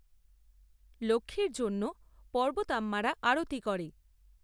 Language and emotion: Bengali, neutral